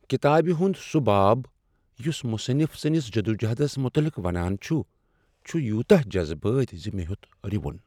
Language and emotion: Kashmiri, sad